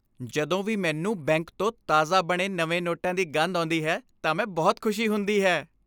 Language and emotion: Punjabi, happy